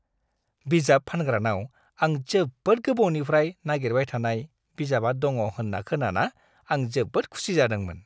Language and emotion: Bodo, happy